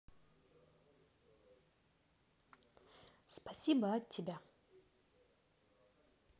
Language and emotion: Russian, positive